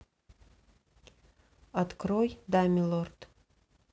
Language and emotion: Russian, neutral